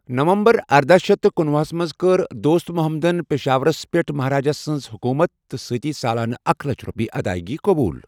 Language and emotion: Kashmiri, neutral